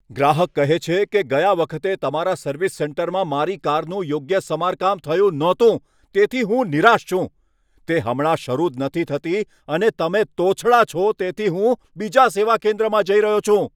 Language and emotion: Gujarati, angry